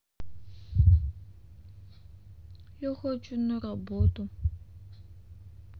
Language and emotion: Russian, sad